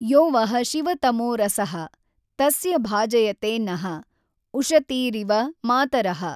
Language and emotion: Kannada, neutral